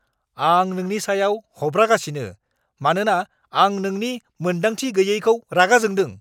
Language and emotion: Bodo, angry